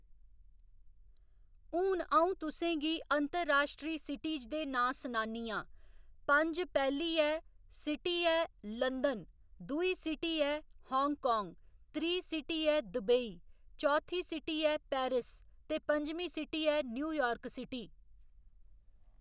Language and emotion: Dogri, neutral